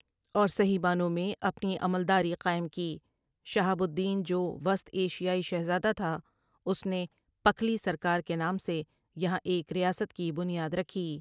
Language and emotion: Urdu, neutral